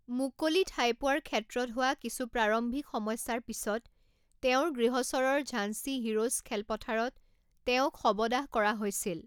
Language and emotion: Assamese, neutral